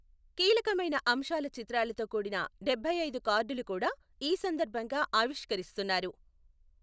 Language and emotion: Telugu, neutral